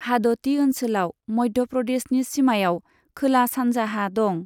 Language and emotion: Bodo, neutral